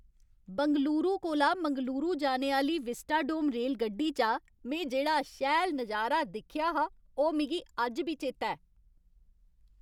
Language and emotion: Dogri, happy